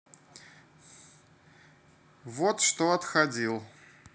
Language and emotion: Russian, neutral